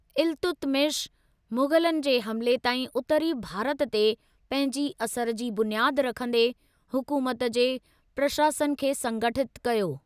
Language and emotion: Sindhi, neutral